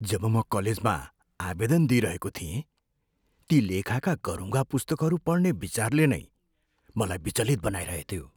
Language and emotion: Nepali, fearful